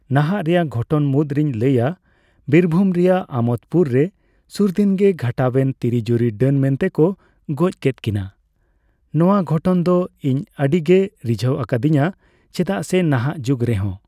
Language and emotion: Santali, neutral